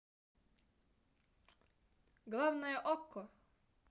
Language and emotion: Russian, positive